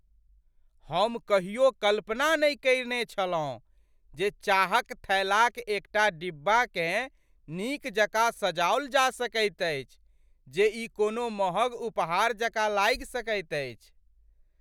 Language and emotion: Maithili, surprised